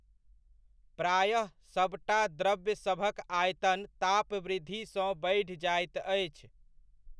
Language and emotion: Maithili, neutral